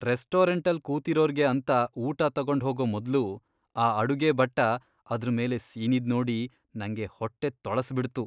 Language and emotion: Kannada, disgusted